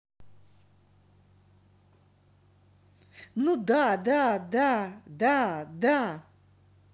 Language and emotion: Russian, positive